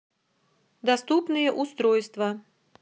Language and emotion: Russian, neutral